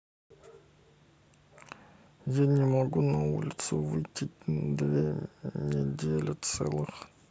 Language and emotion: Russian, sad